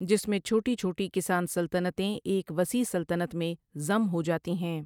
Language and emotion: Urdu, neutral